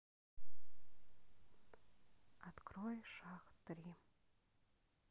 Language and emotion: Russian, sad